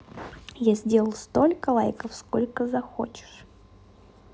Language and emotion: Russian, neutral